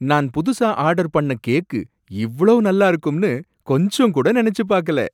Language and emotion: Tamil, surprised